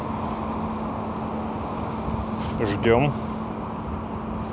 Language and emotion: Russian, neutral